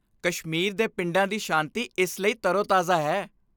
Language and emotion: Punjabi, happy